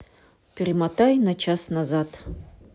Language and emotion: Russian, neutral